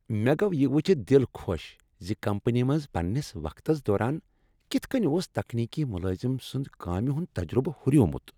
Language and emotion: Kashmiri, happy